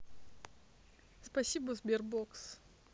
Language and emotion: Russian, neutral